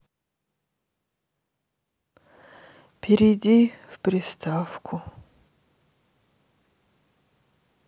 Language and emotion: Russian, sad